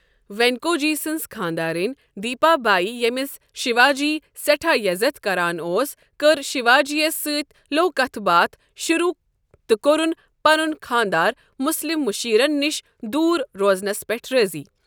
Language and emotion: Kashmiri, neutral